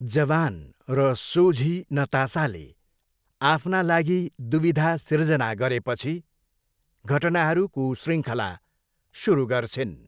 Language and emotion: Nepali, neutral